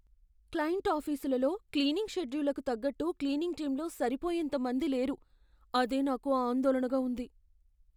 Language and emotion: Telugu, fearful